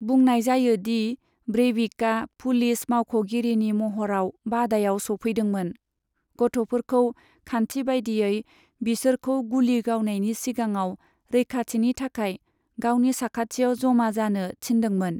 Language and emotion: Bodo, neutral